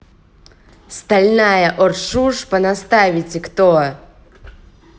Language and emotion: Russian, angry